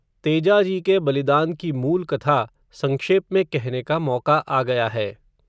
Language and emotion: Hindi, neutral